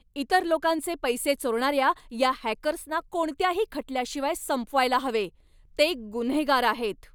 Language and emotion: Marathi, angry